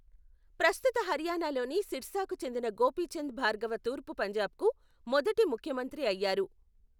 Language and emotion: Telugu, neutral